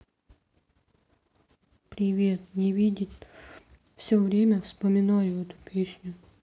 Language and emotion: Russian, sad